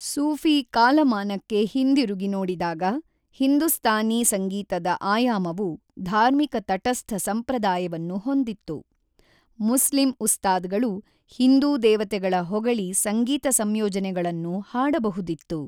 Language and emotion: Kannada, neutral